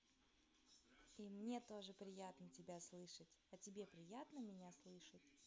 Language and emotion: Russian, positive